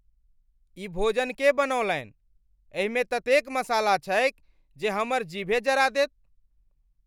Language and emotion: Maithili, angry